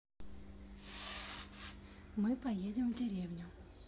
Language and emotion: Russian, neutral